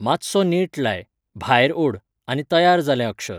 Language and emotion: Goan Konkani, neutral